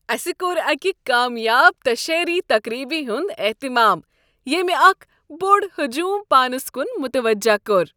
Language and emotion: Kashmiri, happy